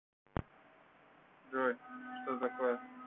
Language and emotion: Russian, neutral